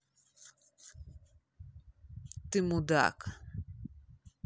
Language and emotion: Russian, angry